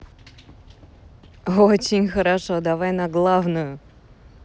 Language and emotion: Russian, positive